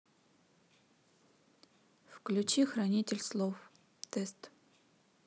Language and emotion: Russian, neutral